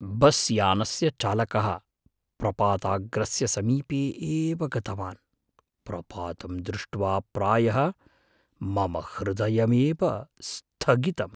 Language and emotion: Sanskrit, fearful